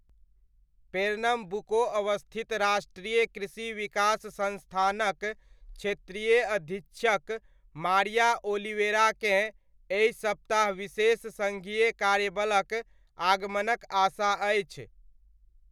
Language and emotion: Maithili, neutral